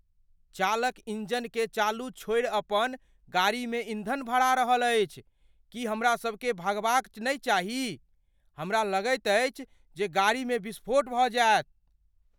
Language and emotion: Maithili, fearful